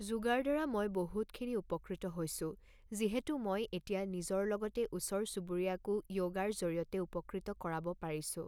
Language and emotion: Assamese, neutral